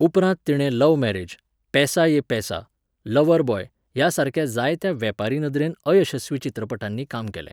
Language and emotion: Goan Konkani, neutral